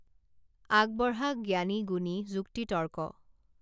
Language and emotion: Assamese, neutral